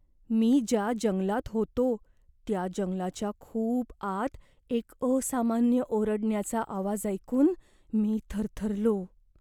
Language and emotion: Marathi, fearful